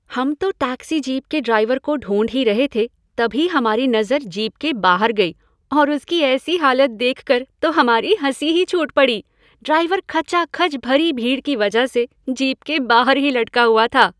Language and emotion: Hindi, happy